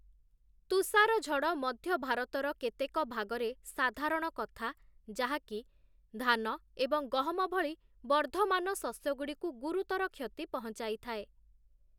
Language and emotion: Odia, neutral